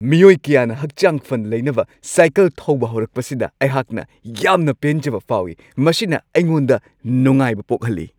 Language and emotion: Manipuri, happy